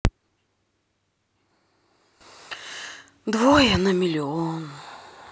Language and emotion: Russian, sad